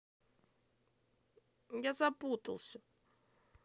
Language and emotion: Russian, sad